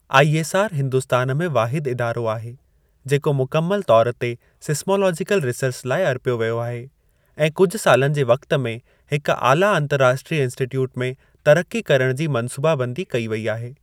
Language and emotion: Sindhi, neutral